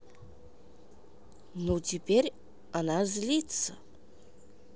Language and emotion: Russian, neutral